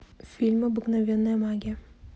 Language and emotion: Russian, neutral